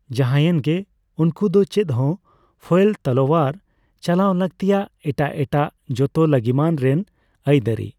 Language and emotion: Santali, neutral